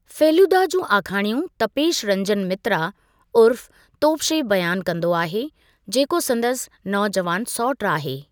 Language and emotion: Sindhi, neutral